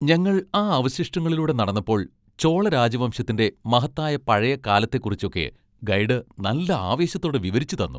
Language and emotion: Malayalam, happy